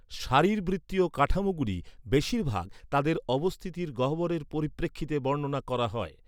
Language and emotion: Bengali, neutral